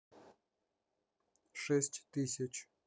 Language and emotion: Russian, neutral